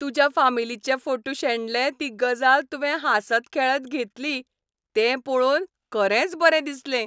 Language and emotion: Goan Konkani, happy